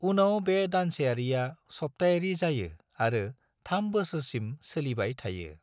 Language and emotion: Bodo, neutral